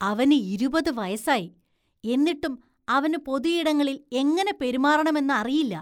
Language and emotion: Malayalam, disgusted